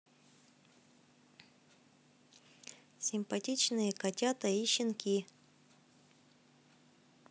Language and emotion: Russian, positive